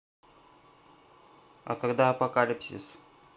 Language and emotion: Russian, neutral